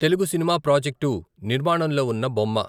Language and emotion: Telugu, neutral